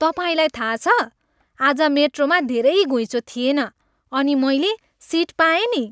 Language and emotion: Nepali, happy